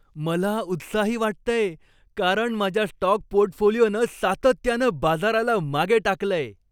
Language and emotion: Marathi, happy